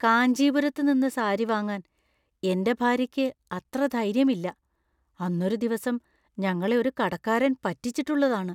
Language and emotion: Malayalam, fearful